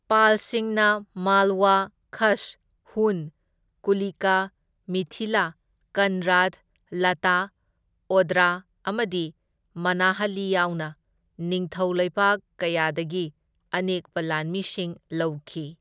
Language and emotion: Manipuri, neutral